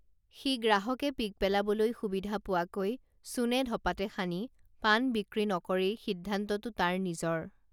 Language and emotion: Assamese, neutral